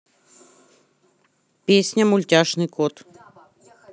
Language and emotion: Russian, neutral